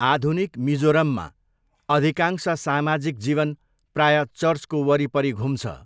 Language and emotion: Nepali, neutral